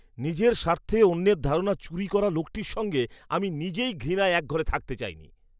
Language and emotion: Bengali, disgusted